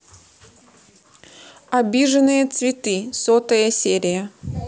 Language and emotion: Russian, neutral